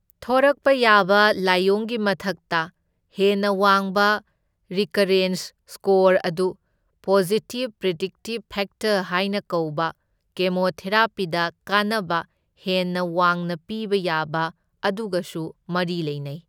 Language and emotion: Manipuri, neutral